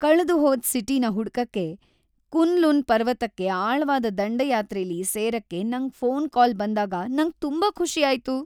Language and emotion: Kannada, happy